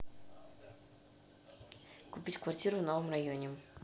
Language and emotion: Russian, neutral